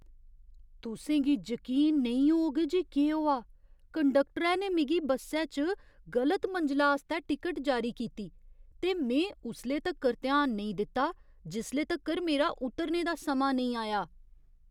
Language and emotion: Dogri, surprised